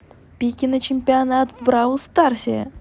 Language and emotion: Russian, positive